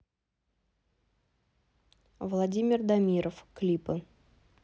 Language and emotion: Russian, neutral